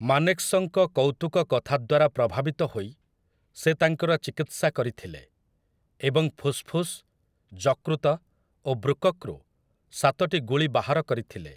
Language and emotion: Odia, neutral